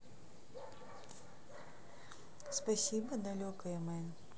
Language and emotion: Russian, neutral